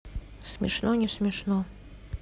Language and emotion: Russian, neutral